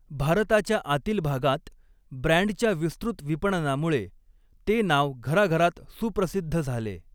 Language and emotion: Marathi, neutral